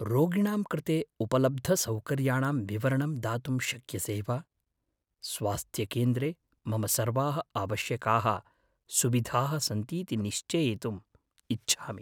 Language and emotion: Sanskrit, fearful